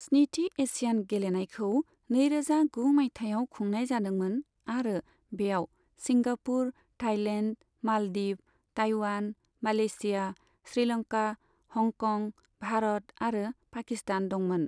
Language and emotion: Bodo, neutral